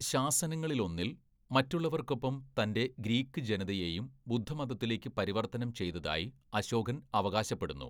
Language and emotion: Malayalam, neutral